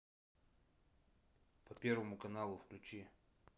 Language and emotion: Russian, neutral